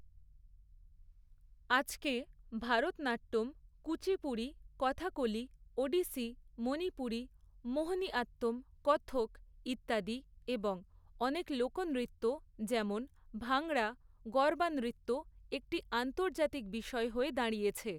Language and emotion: Bengali, neutral